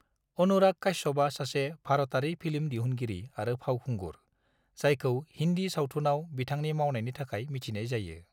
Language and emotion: Bodo, neutral